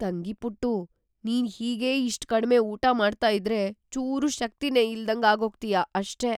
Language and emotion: Kannada, fearful